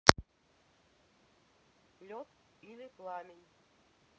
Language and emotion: Russian, neutral